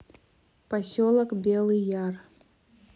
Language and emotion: Russian, neutral